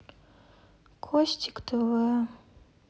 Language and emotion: Russian, sad